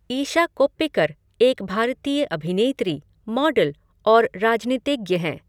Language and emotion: Hindi, neutral